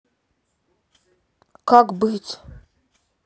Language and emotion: Russian, sad